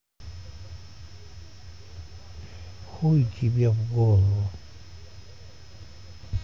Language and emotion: Russian, neutral